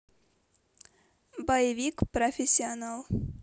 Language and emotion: Russian, neutral